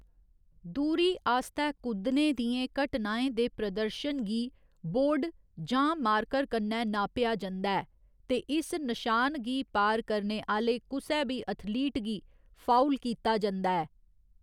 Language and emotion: Dogri, neutral